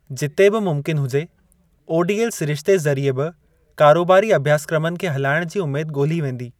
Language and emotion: Sindhi, neutral